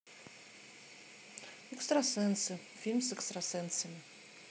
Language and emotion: Russian, neutral